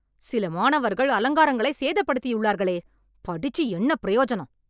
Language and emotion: Tamil, angry